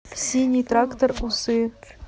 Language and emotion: Russian, neutral